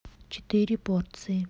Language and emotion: Russian, neutral